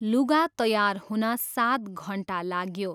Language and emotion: Nepali, neutral